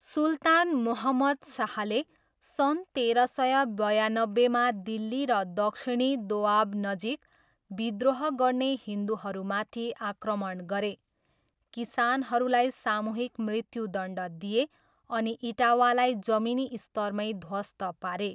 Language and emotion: Nepali, neutral